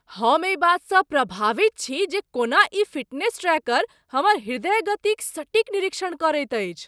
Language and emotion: Maithili, surprised